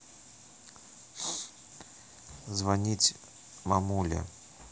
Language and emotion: Russian, neutral